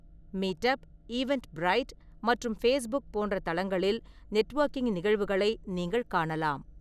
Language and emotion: Tamil, neutral